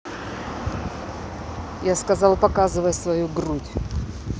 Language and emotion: Russian, neutral